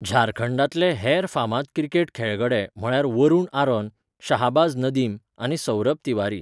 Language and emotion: Goan Konkani, neutral